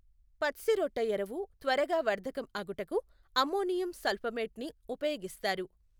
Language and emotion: Telugu, neutral